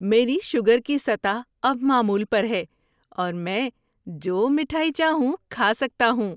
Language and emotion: Urdu, happy